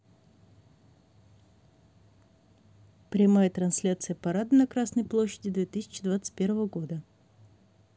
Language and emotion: Russian, neutral